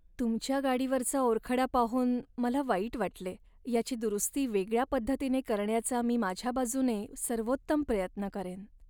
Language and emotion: Marathi, sad